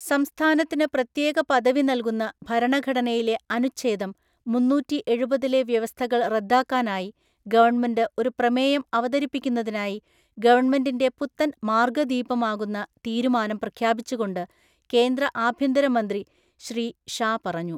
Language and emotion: Malayalam, neutral